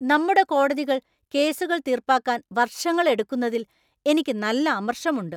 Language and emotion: Malayalam, angry